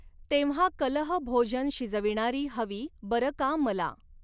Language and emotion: Marathi, neutral